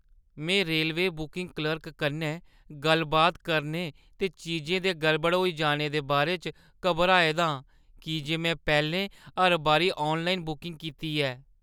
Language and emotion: Dogri, fearful